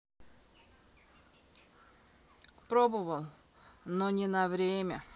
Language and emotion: Russian, neutral